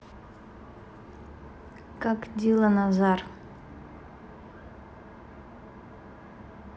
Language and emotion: Russian, neutral